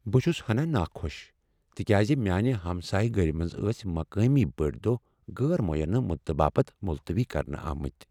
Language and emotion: Kashmiri, sad